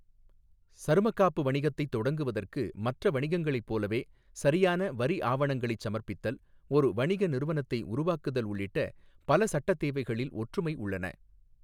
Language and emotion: Tamil, neutral